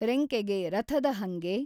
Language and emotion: Kannada, neutral